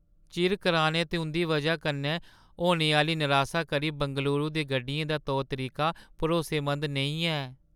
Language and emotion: Dogri, sad